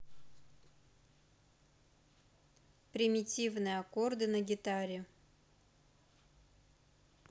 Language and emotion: Russian, neutral